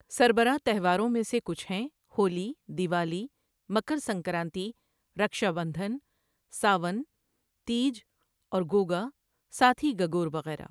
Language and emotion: Urdu, neutral